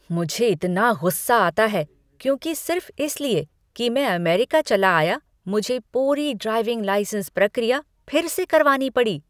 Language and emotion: Hindi, angry